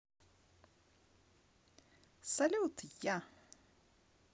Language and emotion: Russian, positive